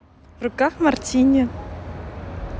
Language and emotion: Russian, positive